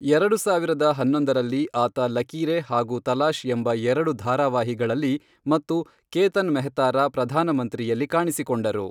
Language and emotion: Kannada, neutral